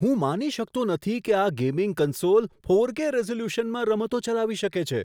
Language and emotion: Gujarati, surprised